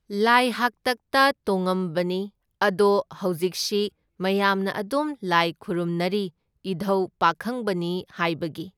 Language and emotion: Manipuri, neutral